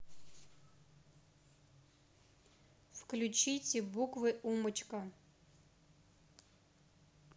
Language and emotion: Russian, neutral